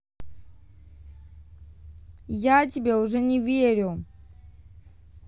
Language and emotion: Russian, angry